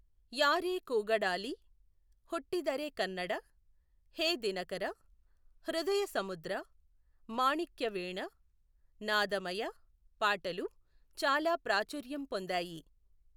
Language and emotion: Telugu, neutral